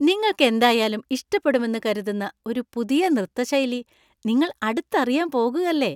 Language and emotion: Malayalam, happy